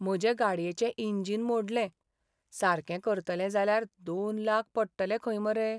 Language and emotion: Goan Konkani, sad